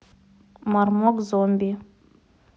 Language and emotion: Russian, neutral